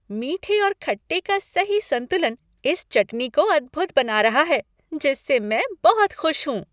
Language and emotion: Hindi, happy